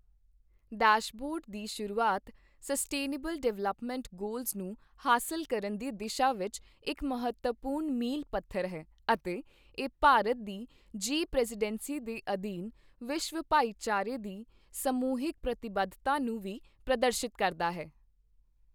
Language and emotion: Punjabi, neutral